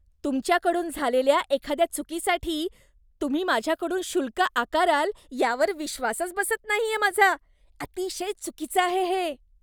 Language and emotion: Marathi, disgusted